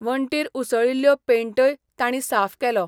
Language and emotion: Goan Konkani, neutral